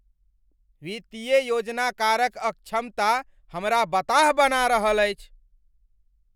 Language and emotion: Maithili, angry